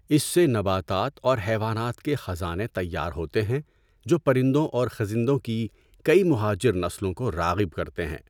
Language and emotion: Urdu, neutral